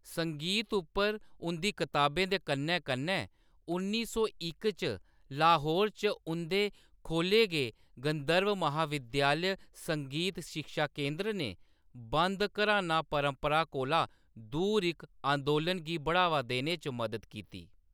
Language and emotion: Dogri, neutral